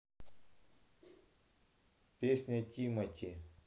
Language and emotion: Russian, neutral